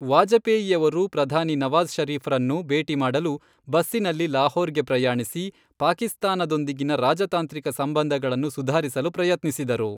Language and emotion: Kannada, neutral